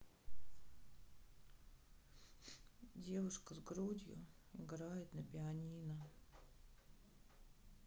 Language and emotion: Russian, sad